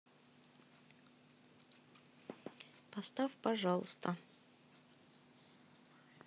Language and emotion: Russian, neutral